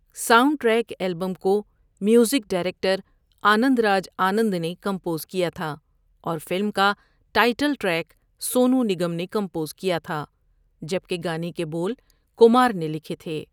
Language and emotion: Urdu, neutral